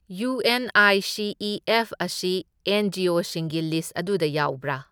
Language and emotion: Manipuri, neutral